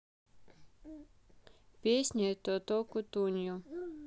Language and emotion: Russian, neutral